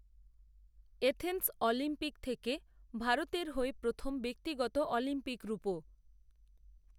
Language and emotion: Bengali, neutral